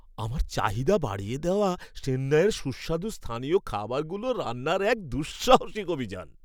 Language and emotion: Bengali, happy